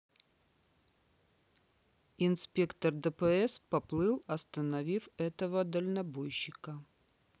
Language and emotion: Russian, neutral